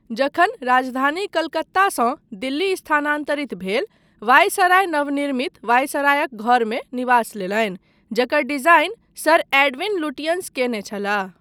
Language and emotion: Maithili, neutral